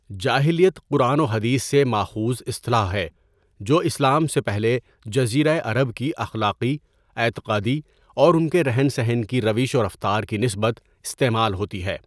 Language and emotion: Urdu, neutral